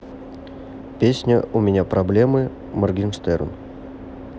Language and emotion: Russian, neutral